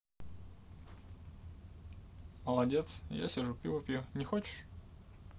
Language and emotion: Russian, neutral